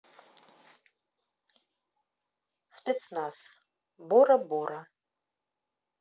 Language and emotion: Russian, neutral